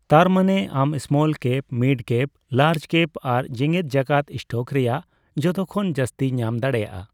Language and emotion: Santali, neutral